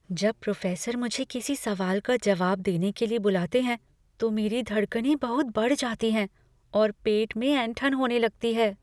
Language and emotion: Hindi, fearful